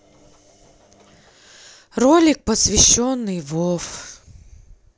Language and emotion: Russian, sad